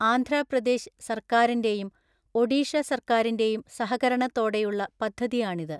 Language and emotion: Malayalam, neutral